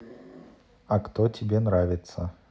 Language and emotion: Russian, neutral